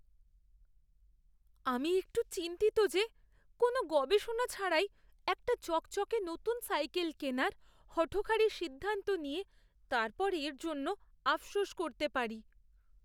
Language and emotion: Bengali, fearful